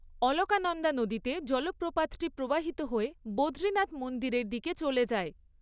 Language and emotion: Bengali, neutral